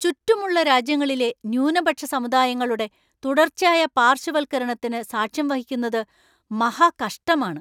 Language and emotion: Malayalam, angry